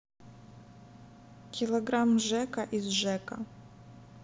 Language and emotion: Russian, neutral